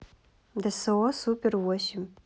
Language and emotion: Russian, neutral